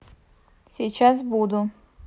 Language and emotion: Russian, neutral